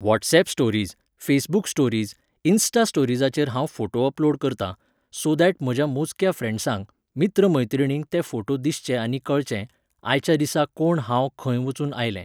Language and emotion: Goan Konkani, neutral